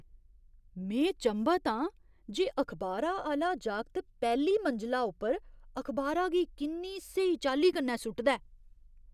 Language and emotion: Dogri, surprised